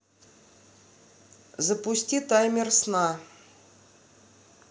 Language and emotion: Russian, neutral